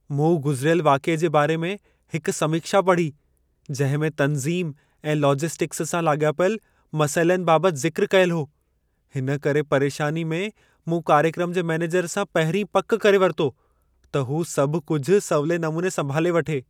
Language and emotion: Sindhi, fearful